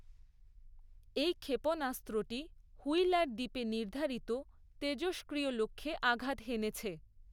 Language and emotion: Bengali, neutral